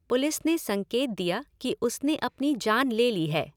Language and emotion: Hindi, neutral